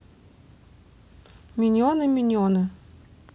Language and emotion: Russian, neutral